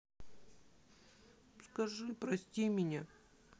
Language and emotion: Russian, sad